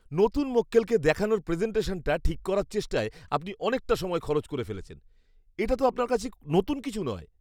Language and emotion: Bengali, disgusted